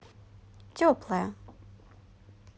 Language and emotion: Russian, neutral